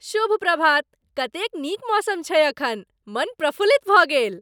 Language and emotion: Maithili, happy